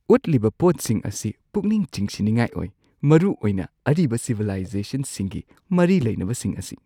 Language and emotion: Manipuri, surprised